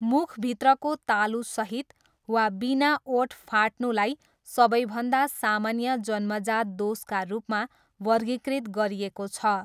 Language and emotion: Nepali, neutral